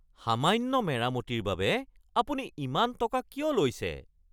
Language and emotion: Assamese, angry